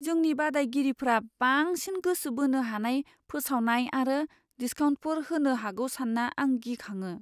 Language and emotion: Bodo, fearful